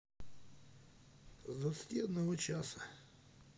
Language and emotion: Russian, neutral